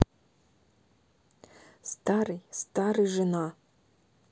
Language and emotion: Russian, neutral